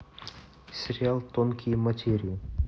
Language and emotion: Russian, neutral